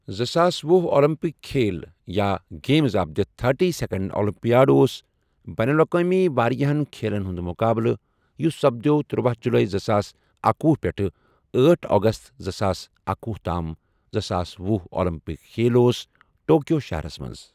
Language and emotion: Kashmiri, neutral